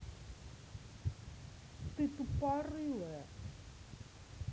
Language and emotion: Russian, angry